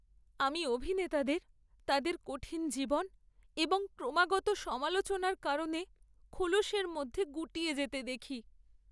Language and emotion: Bengali, sad